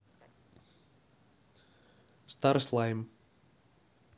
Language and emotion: Russian, neutral